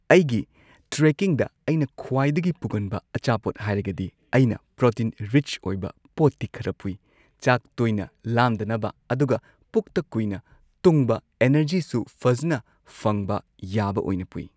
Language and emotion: Manipuri, neutral